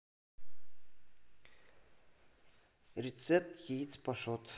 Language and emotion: Russian, neutral